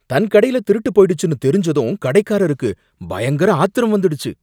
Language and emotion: Tamil, angry